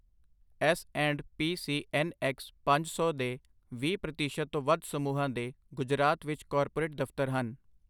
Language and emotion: Punjabi, neutral